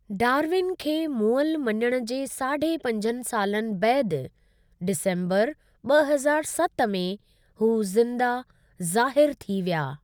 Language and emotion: Sindhi, neutral